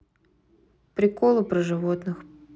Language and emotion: Russian, neutral